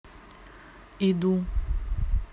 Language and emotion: Russian, neutral